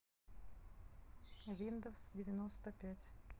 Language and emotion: Russian, neutral